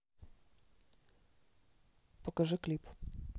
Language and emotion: Russian, neutral